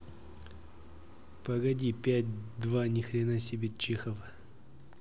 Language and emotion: Russian, neutral